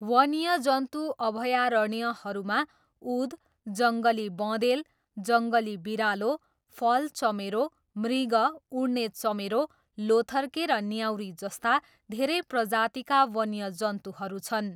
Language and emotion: Nepali, neutral